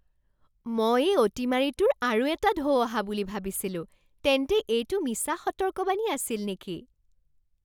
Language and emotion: Assamese, surprised